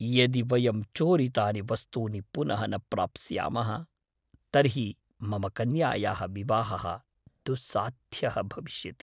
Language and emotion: Sanskrit, fearful